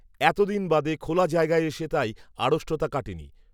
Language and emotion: Bengali, neutral